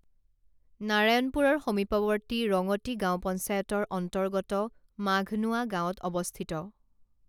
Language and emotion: Assamese, neutral